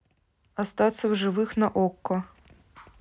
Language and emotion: Russian, neutral